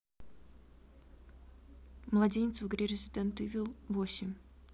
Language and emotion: Russian, neutral